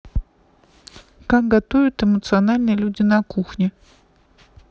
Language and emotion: Russian, neutral